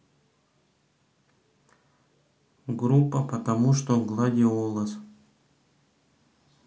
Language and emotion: Russian, neutral